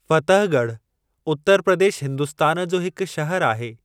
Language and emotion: Sindhi, neutral